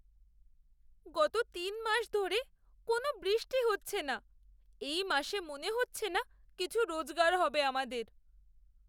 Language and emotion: Bengali, sad